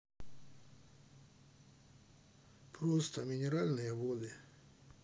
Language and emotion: Russian, sad